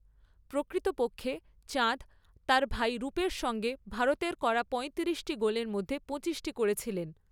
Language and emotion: Bengali, neutral